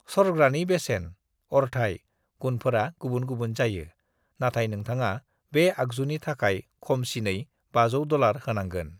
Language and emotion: Bodo, neutral